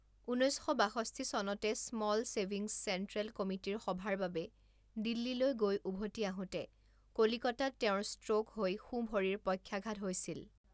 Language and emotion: Assamese, neutral